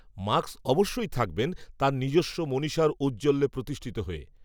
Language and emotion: Bengali, neutral